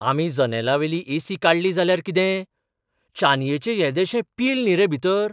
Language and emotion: Goan Konkani, surprised